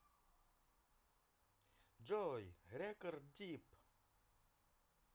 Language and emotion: Russian, positive